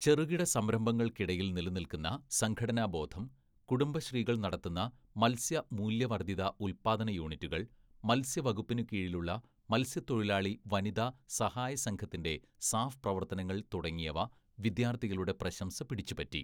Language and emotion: Malayalam, neutral